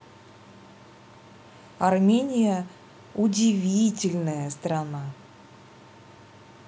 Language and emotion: Russian, positive